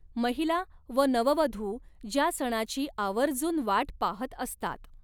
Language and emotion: Marathi, neutral